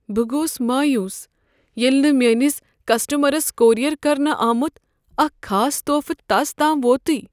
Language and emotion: Kashmiri, sad